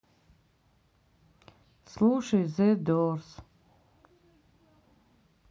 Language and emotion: Russian, sad